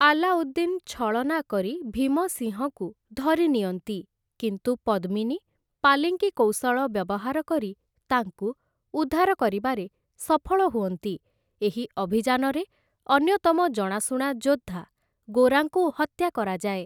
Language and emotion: Odia, neutral